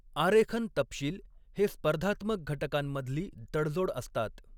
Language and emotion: Marathi, neutral